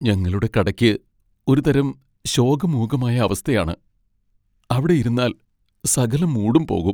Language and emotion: Malayalam, sad